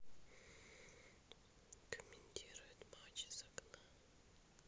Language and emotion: Russian, neutral